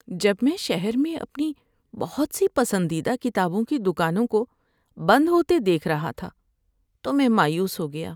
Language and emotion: Urdu, sad